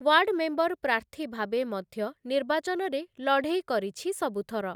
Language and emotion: Odia, neutral